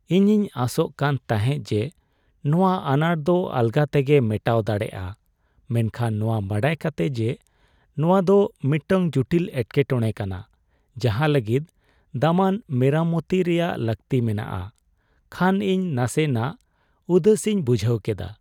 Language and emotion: Santali, sad